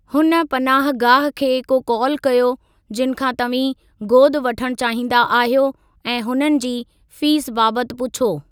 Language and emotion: Sindhi, neutral